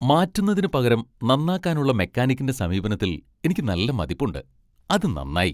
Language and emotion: Malayalam, happy